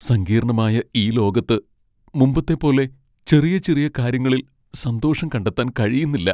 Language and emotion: Malayalam, sad